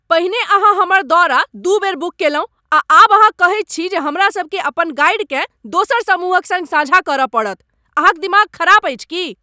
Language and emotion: Maithili, angry